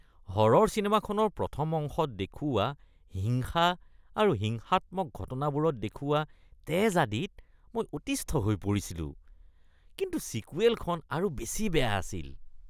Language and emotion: Assamese, disgusted